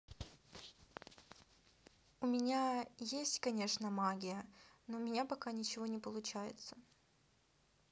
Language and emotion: Russian, neutral